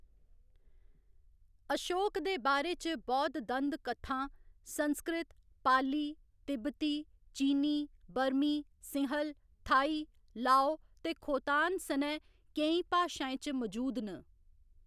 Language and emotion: Dogri, neutral